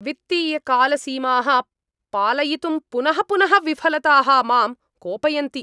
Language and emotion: Sanskrit, angry